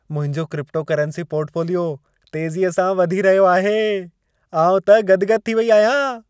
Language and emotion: Sindhi, happy